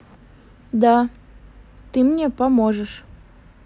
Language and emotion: Russian, neutral